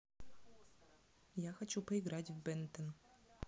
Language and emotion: Russian, neutral